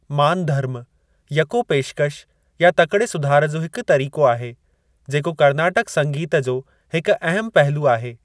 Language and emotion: Sindhi, neutral